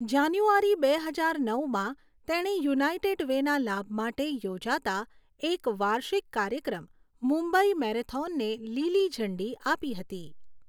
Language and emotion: Gujarati, neutral